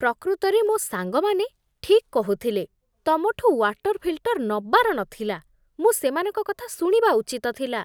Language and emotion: Odia, disgusted